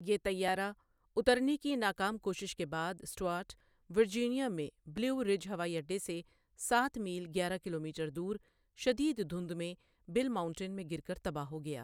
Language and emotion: Urdu, neutral